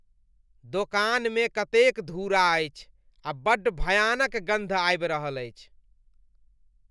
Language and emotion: Maithili, disgusted